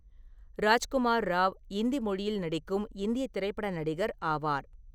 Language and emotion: Tamil, neutral